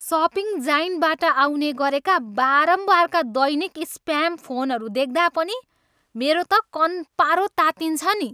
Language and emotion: Nepali, angry